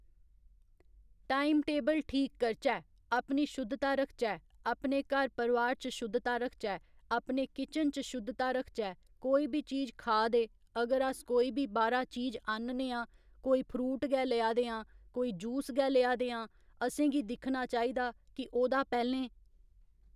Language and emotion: Dogri, neutral